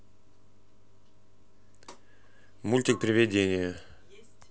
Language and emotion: Russian, neutral